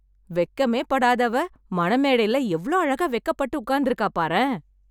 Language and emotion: Tamil, happy